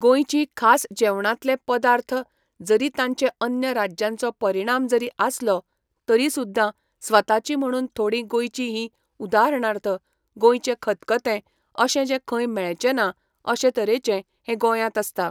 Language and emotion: Goan Konkani, neutral